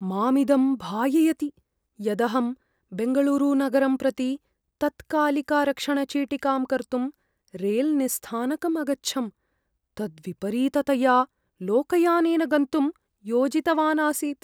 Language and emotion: Sanskrit, fearful